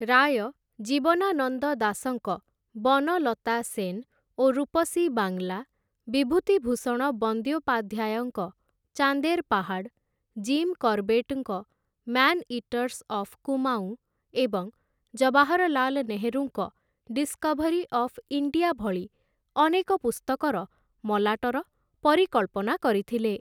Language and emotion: Odia, neutral